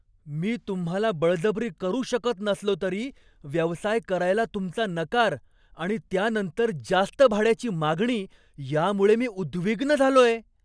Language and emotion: Marathi, surprised